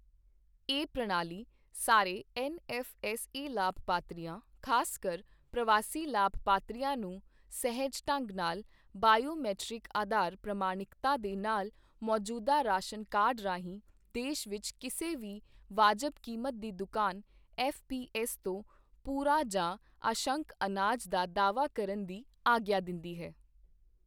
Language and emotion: Punjabi, neutral